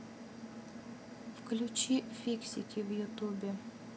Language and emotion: Russian, neutral